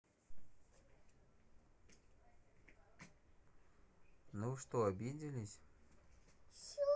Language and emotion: Russian, neutral